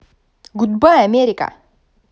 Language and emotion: Russian, positive